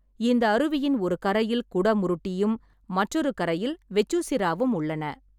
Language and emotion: Tamil, neutral